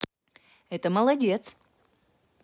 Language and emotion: Russian, positive